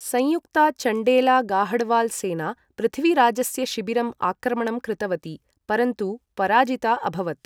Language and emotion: Sanskrit, neutral